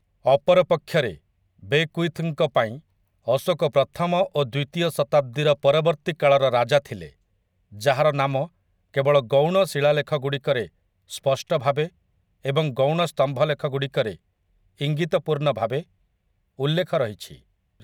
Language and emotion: Odia, neutral